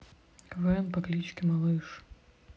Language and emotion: Russian, neutral